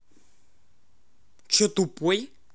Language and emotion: Russian, angry